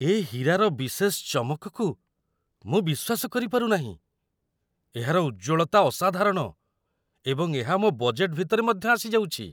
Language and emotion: Odia, surprised